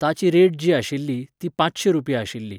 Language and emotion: Goan Konkani, neutral